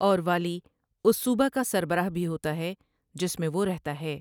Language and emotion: Urdu, neutral